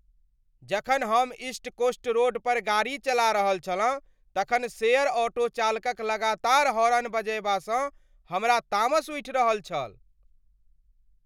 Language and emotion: Maithili, angry